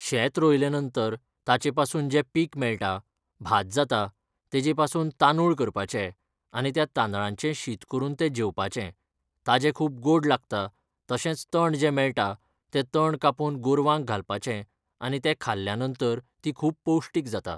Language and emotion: Goan Konkani, neutral